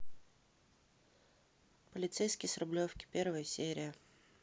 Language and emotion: Russian, neutral